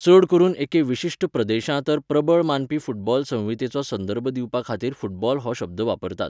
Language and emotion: Goan Konkani, neutral